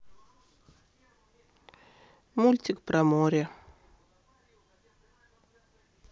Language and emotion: Russian, neutral